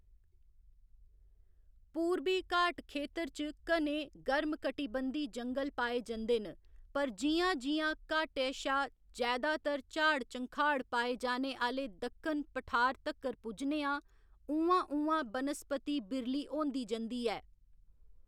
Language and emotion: Dogri, neutral